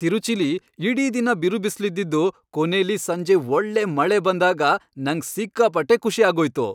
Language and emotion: Kannada, happy